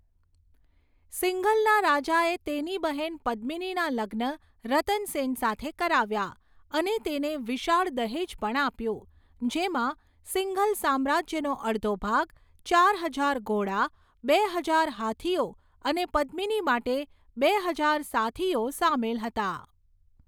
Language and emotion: Gujarati, neutral